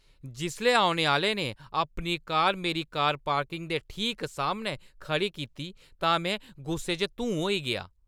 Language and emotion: Dogri, angry